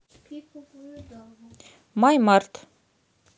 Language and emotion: Russian, neutral